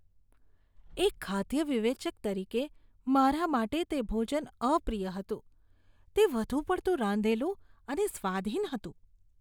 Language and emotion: Gujarati, disgusted